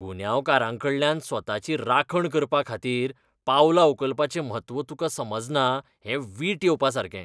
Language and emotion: Goan Konkani, disgusted